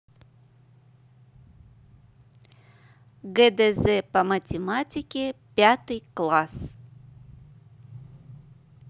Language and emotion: Russian, neutral